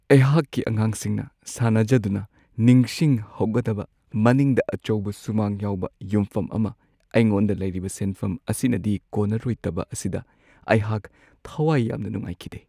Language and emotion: Manipuri, sad